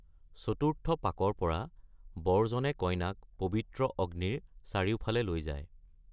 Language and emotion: Assamese, neutral